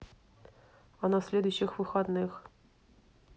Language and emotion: Russian, neutral